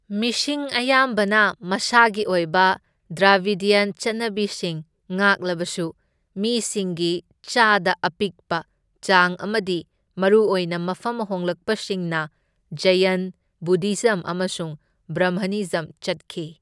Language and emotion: Manipuri, neutral